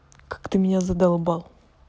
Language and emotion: Russian, angry